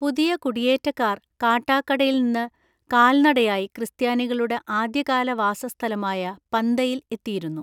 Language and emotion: Malayalam, neutral